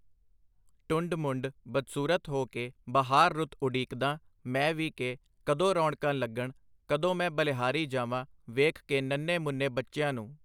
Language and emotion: Punjabi, neutral